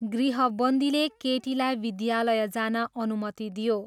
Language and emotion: Nepali, neutral